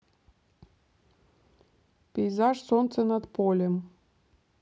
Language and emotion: Russian, neutral